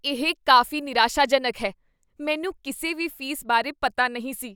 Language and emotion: Punjabi, disgusted